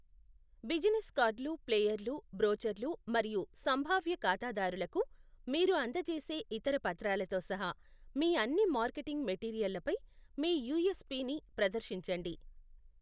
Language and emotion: Telugu, neutral